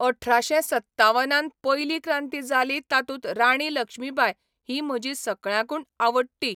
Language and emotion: Goan Konkani, neutral